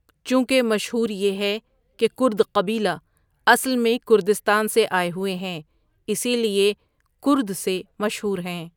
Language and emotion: Urdu, neutral